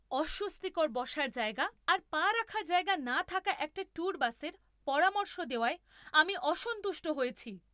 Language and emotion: Bengali, angry